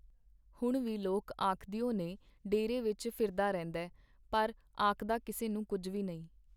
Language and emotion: Punjabi, neutral